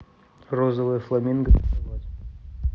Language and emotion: Russian, neutral